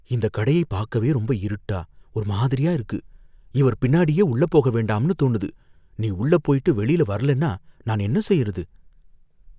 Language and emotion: Tamil, fearful